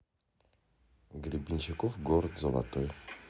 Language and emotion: Russian, neutral